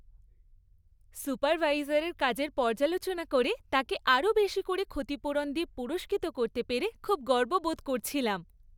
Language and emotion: Bengali, happy